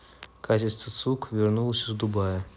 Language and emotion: Russian, neutral